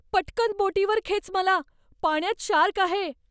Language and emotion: Marathi, fearful